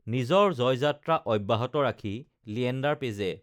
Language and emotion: Assamese, neutral